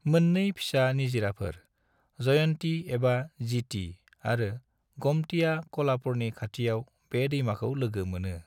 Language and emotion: Bodo, neutral